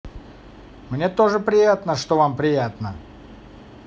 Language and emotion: Russian, positive